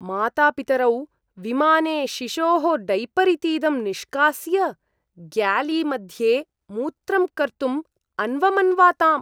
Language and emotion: Sanskrit, disgusted